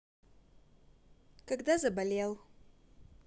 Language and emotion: Russian, positive